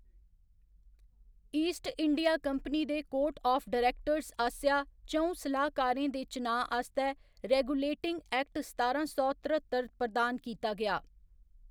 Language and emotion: Dogri, neutral